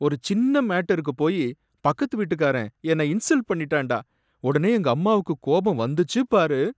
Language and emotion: Tamil, sad